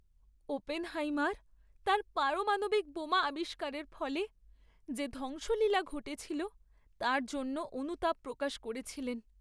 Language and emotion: Bengali, sad